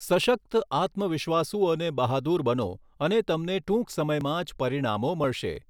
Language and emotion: Gujarati, neutral